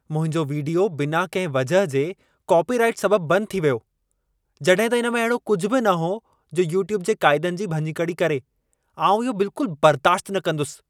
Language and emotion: Sindhi, angry